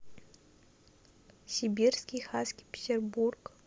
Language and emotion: Russian, neutral